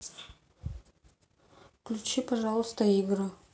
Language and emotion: Russian, sad